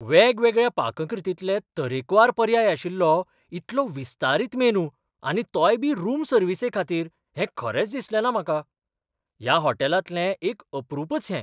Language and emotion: Goan Konkani, surprised